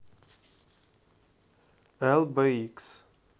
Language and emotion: Russian, neutral